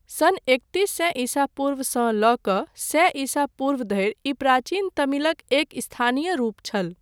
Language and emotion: Maithili, neutral